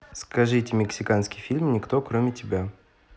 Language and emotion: Russian, neutral